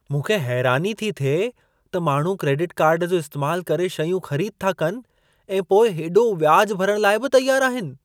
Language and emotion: Sindhi, surprised